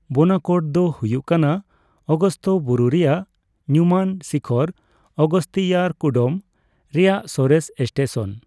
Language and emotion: Santali, neutral